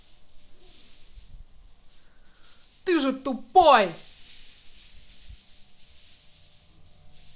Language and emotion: Russian, angry